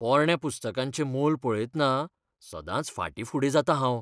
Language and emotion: Goan Konkani, fearful